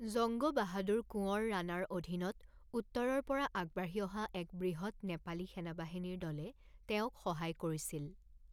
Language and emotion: Assamese, neutral